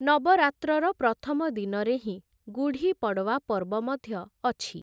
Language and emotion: Odia, neutral